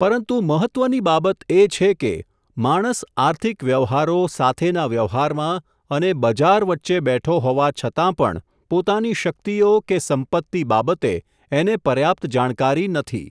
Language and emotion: Gujarati, neutral